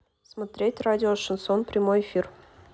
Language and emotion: Russian, neutral